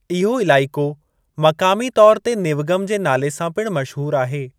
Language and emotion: Sindhi, neutral